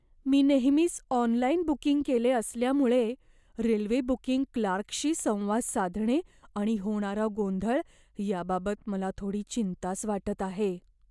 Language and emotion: Marathi, fearful